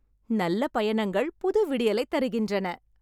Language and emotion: Tamil, happy